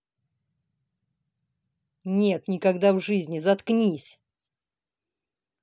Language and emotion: Russian, angry